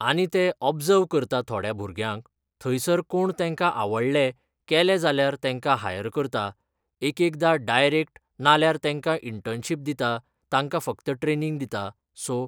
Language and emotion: Goan Konkani, neutral